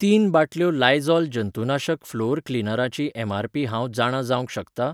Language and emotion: Goan Konkani, neutral